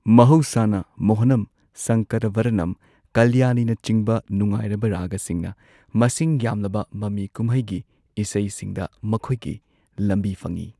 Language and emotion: Manipuri, neutral